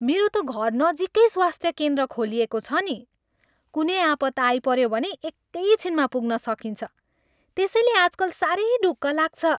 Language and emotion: Nepali, happy